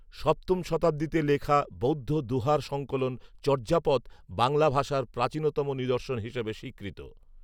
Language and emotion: Bengali, neutral